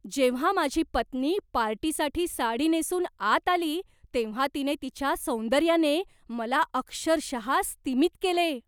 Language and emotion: Marathi, surprised